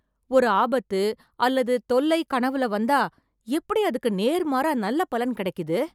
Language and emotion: Tamil, surprised